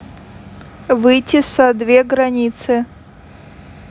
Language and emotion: Russian, neutral